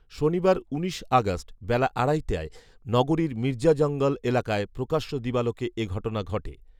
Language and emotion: Bengali, neutral